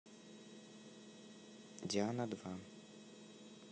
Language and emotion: Russian, neutral